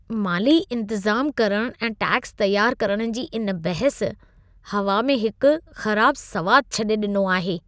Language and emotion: Sindhi, disgusted